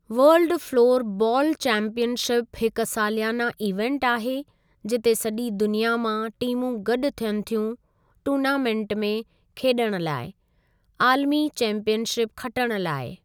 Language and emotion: Sindhi, neutral